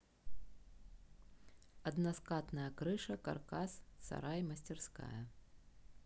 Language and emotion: Russian, neutral